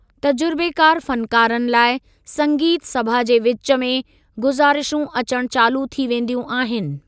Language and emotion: Sindhi, neutral